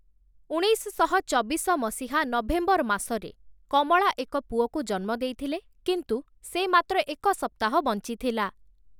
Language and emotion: Odia, neutral